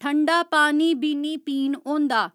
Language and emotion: Dogri, neutral